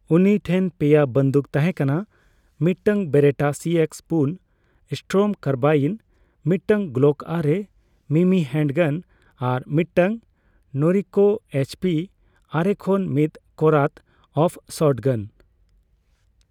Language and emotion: Santali, neutral